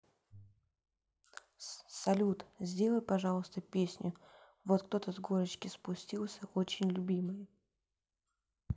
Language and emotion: Russian, neutral